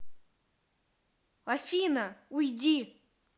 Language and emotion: Russian, angry